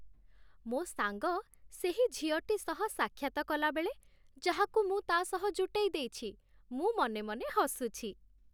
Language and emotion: Odia, happy